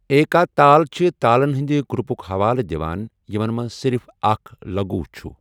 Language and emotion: Kashmiri, neutral